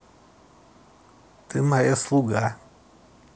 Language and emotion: Russian, neutral